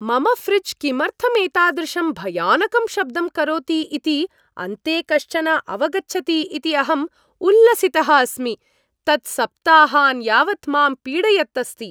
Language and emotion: Sanskrit, happy